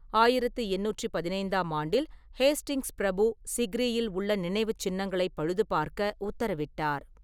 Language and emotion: Tamil, neutral